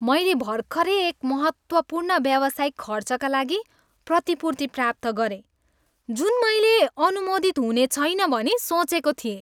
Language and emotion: Nepali, happy